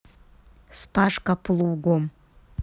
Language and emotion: Russian, neutral